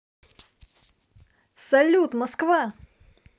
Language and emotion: Russian, positive